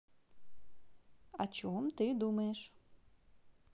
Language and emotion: Russian, positive